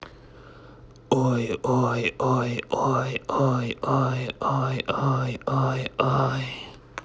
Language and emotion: Russian, neutral